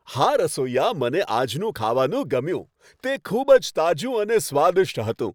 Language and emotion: Gujarati, happy